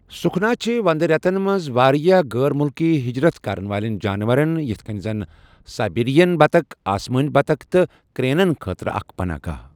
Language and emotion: Kashmiri, neutral